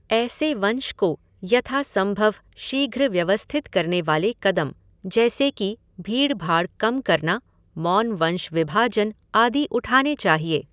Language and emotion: Hindi, neutral